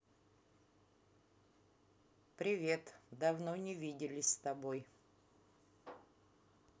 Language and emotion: Russian, neutral